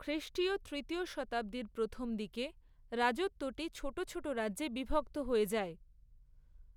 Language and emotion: Bengali, neutral